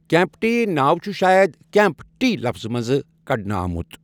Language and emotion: Kashmiri, neutral